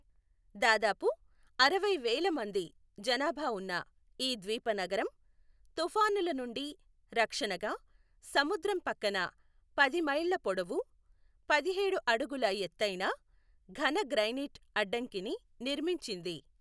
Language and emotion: Telugu, neutral